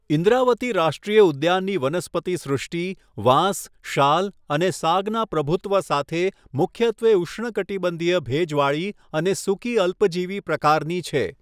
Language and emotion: Gujarati, neutral